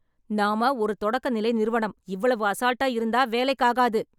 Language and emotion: Tamil, angry